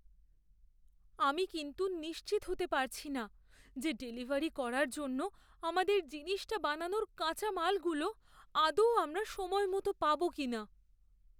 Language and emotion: Bengali, fearful